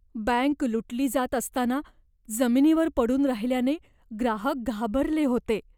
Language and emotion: Marathi, fearful